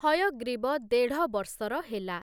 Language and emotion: Odia, neutral